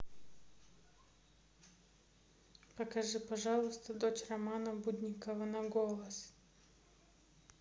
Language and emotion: Russian, neutral